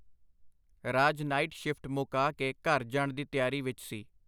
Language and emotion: Punjabi, neutral